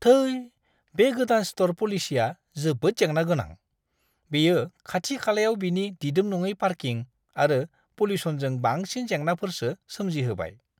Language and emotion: Bodo, disgusted